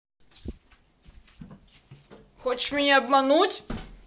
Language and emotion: Russian, angry